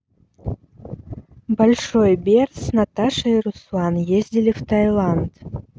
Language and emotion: Russian, neutral